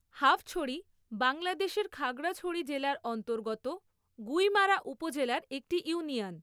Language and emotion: Bengali, neutral